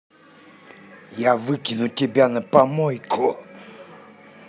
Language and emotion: Russian, angry